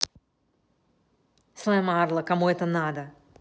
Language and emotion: Russian, angry